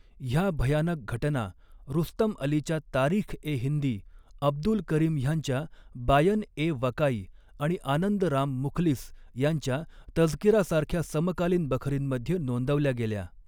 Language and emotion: Marathi, neutral